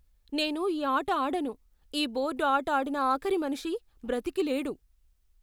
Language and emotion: Telugu, fearful